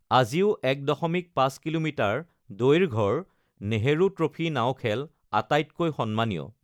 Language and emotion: Assamese, neutral